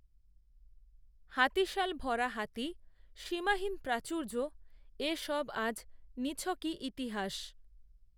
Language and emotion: Bengali, neutral